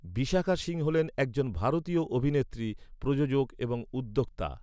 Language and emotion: Bengali, neutral